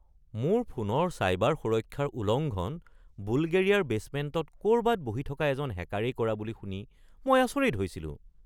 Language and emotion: Assamese, surprised